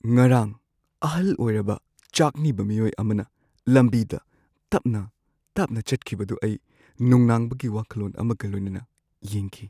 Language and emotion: Manipuri, sad